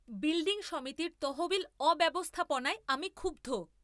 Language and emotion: Bengali, angry